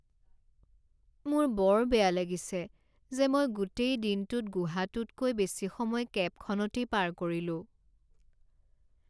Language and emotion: Assamese, sad